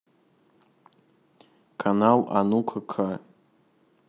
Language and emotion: Russian, neutral